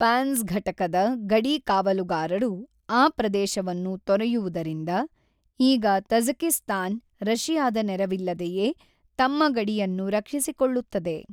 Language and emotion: Kannada, neutral